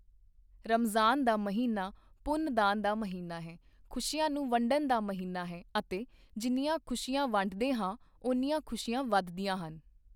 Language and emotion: Punjabi, neutral